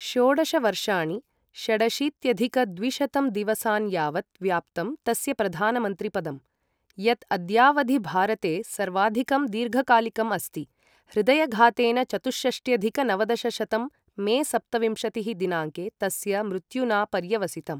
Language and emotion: Sanskrit, neutral